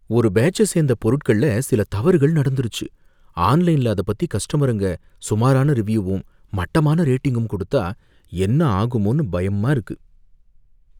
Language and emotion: Tamil, fearful